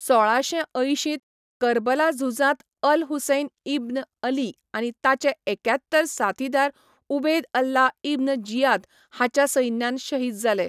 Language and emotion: Goan Konkani, neutral